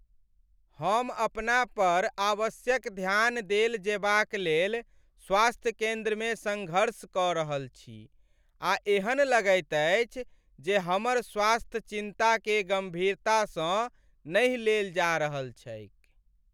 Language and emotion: Maithili, sad